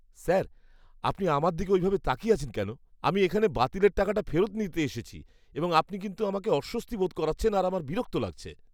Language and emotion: Bengali, disgusted